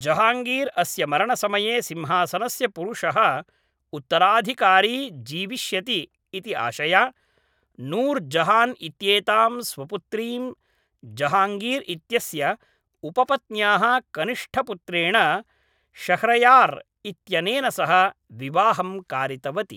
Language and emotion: Sanskrit, neutral